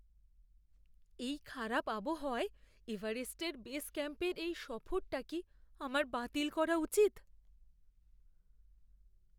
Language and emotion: Bengali, fearful